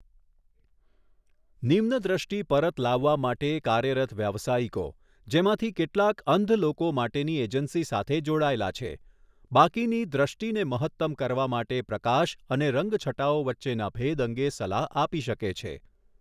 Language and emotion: Gujarati, neutral